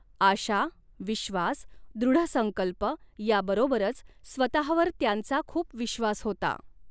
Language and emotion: Marathi, neutral